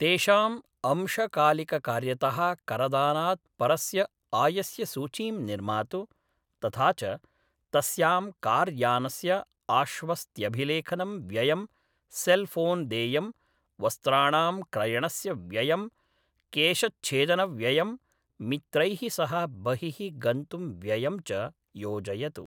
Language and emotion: Sanskrit, neutral